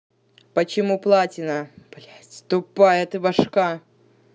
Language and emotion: Russian, angry